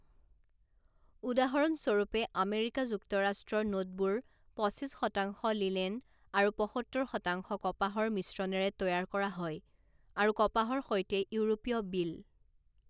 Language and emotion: Assamese, neutral